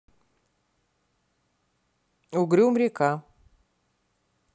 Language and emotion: Russian, neutral